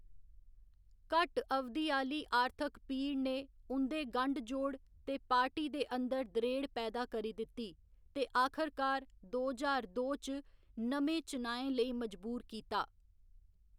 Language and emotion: Dogri, neutral